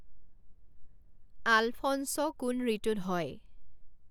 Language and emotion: Assamese, neutral